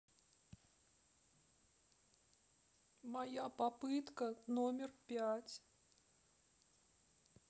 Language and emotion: Russian, sad